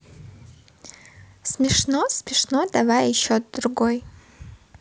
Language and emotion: Russian, positive